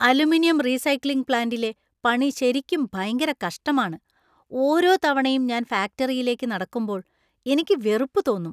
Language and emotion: Malayalam, disgusted